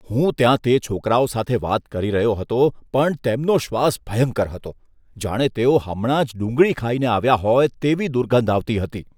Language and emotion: Gujarati, disgusted